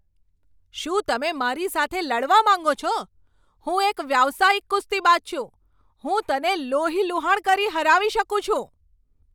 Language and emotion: Gujarati, angry